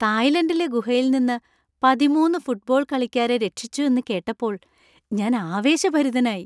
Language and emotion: Malayalam, happy